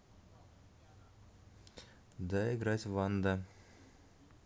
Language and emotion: Russian, neutral